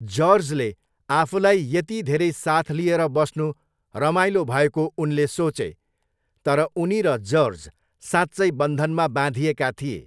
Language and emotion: Nepali, neutral